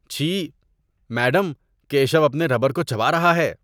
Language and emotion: Urdu, disgusted